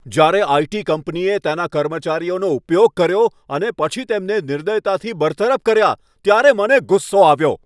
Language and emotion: Gujarati, angry